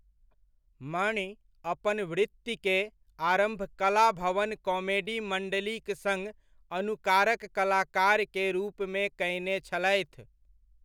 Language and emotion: Maithili, neutral